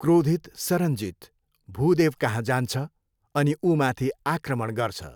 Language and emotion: Nepali, neutral